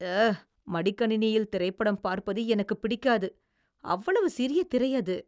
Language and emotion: Tamil, disgusted